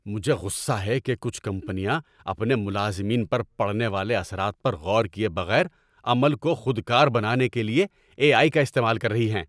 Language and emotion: Urdu, angry